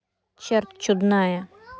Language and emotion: Russian, neutral